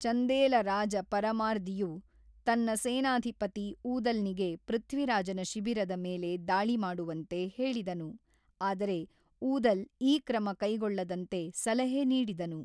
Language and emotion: Kannada, neutral